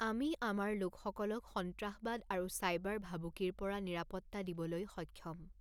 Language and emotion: Assamese, neutral